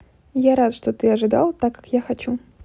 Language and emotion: Russian, neutral